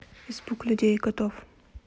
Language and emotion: Russian, neutral